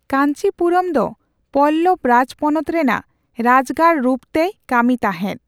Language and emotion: Santali, neutral